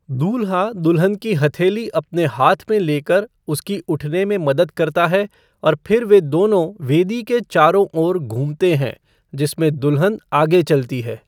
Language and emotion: Hindi, neutral